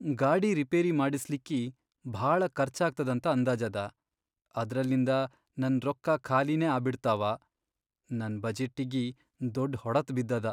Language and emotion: Kannada, sad